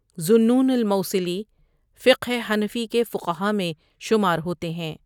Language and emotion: Urdu, neutral